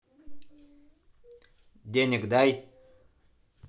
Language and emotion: Russian, angry